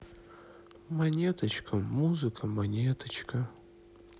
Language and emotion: Russian, sad